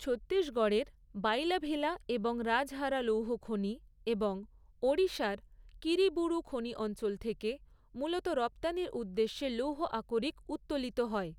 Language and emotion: Bengali, neutral